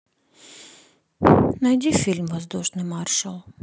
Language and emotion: Russian, sad